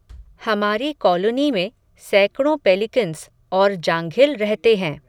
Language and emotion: Hindi, neutral